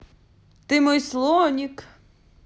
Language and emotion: Russian, positive